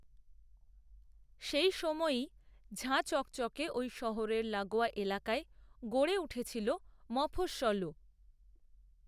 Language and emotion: Bengali, neutral